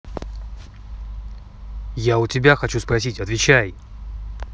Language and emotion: Russian, angry